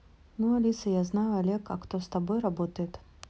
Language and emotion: Russian, neutral